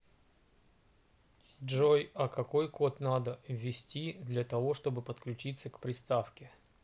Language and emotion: Russian, neutral